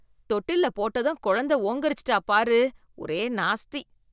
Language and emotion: Tamil, disgusted